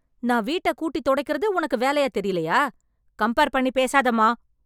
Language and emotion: Tamil, angry